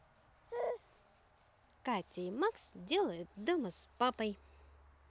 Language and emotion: Russian, neutral